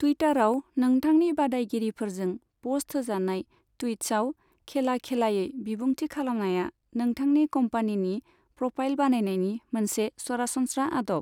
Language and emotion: Bodo, neutral